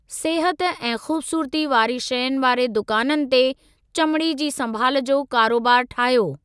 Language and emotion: Sindhi, neutral